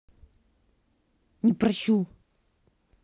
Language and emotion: Russian, angry